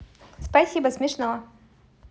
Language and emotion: Russian, positive